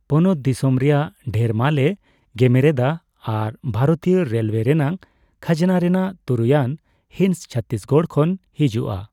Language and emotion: Santali, neutral